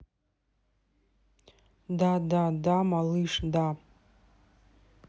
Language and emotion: Russian, neutral